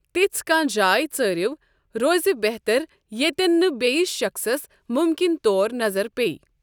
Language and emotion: Kashmiri, neutral